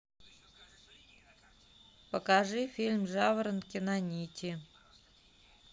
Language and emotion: Russian, neutral